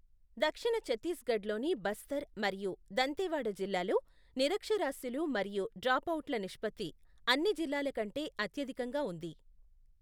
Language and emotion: Telugu, neutral